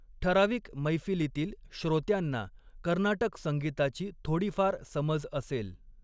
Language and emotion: Marathi, neutral